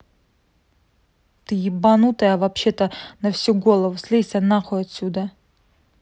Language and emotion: Russian, angry